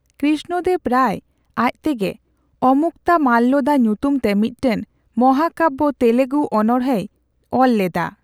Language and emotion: Santali, neutral